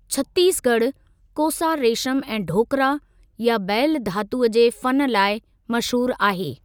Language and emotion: Sindhi, neutral